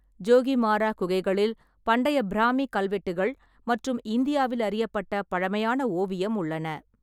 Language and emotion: Tamil, neutral